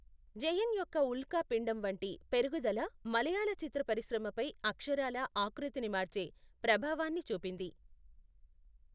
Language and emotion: Telugu, neutral